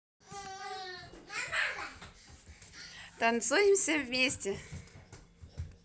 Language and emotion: Russian, positive